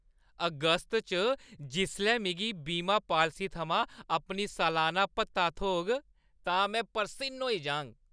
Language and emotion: Dogri, happy